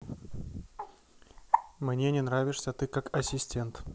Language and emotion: Russian, neutral